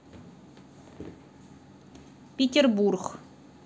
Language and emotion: Russian, neutral